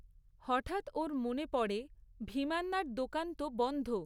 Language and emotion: Bengali, neutral